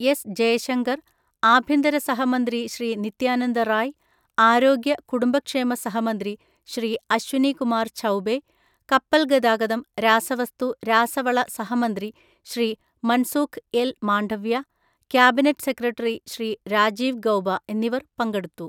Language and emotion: Malayalam, neutral